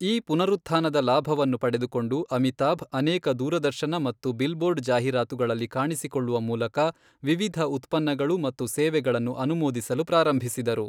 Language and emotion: Kannada, neutral